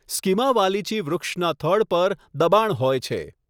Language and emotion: Gujarati, neutral